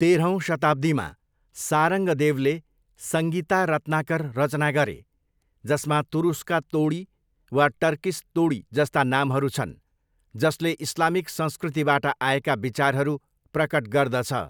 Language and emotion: Nepali, neutral